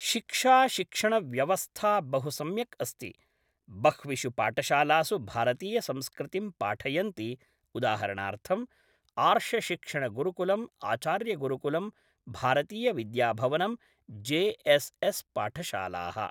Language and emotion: Sanskrit, neutral